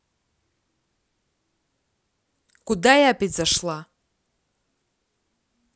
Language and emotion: Russian, angry